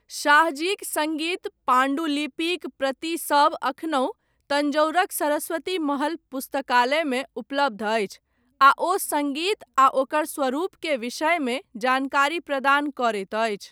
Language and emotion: Maithili, neutral